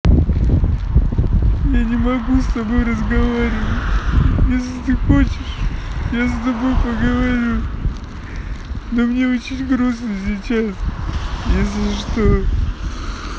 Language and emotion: Russian, sad